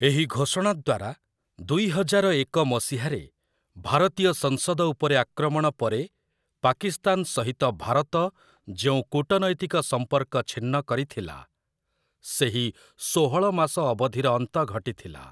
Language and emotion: Odia, neutral